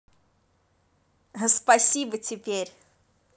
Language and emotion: Russian, positive